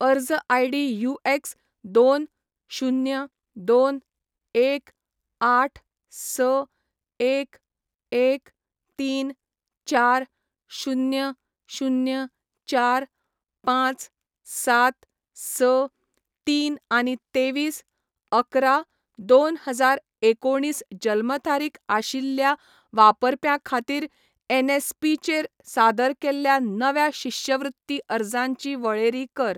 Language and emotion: Goan Konkani, neutral